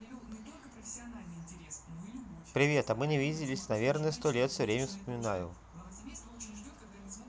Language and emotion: Russian, neutral